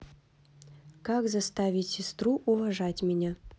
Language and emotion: Russian, neutral